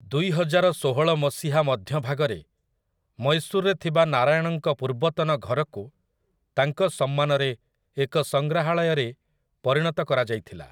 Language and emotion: Odia, neutral